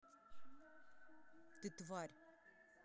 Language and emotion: Russian, angry